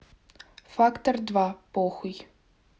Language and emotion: Russian, neutral